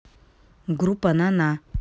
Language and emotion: Russian, neutral